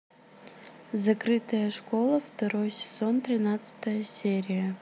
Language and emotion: Russian, neutral